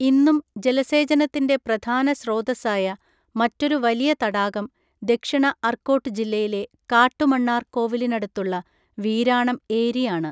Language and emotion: Malayalam, neutral